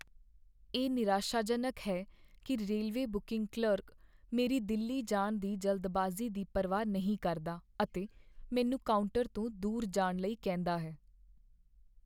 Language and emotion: Punjabi, sad